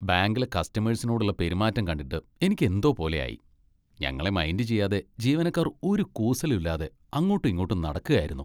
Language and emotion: Malayalam, disgusted